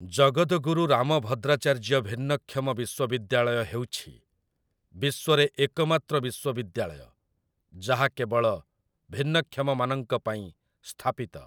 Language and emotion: Odia, neutral